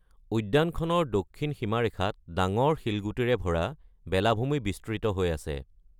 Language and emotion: Assamese, neutral